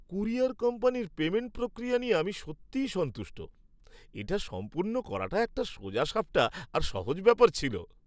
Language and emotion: Bengali, happy